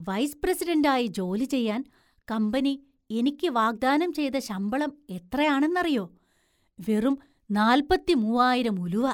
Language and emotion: Malayalam, surprised